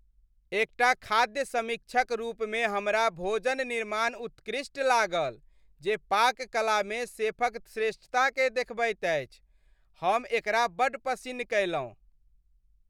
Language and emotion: Maithili, happy